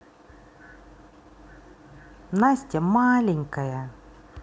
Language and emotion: Russian, neutral